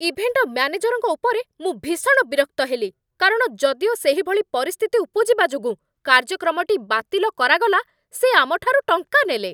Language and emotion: Odia, angry